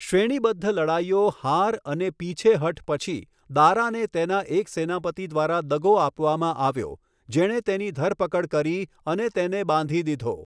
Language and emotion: Gujarati, neutral